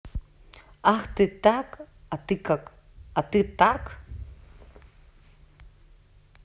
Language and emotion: Russian, neutral